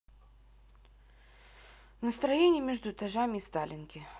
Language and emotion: Russian, sad